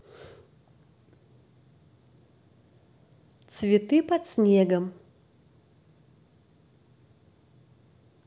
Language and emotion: Russian, neutral